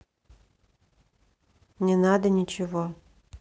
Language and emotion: Russian, neutral